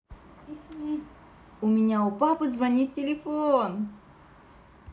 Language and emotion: Russian, positive